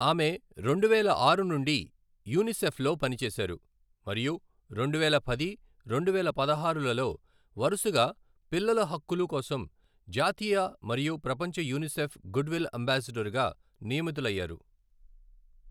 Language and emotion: Telugu, neutral